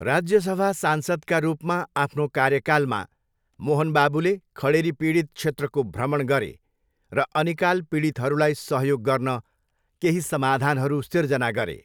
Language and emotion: Nepali, neutral